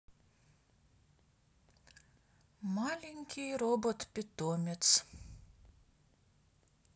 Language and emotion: Russian, neutral